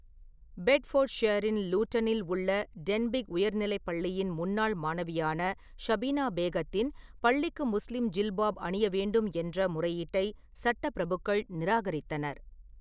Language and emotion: Tamil, neutral